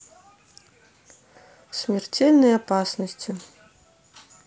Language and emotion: Russian, neutral